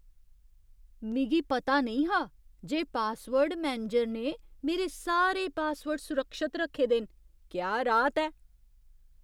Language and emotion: Dogri, surprised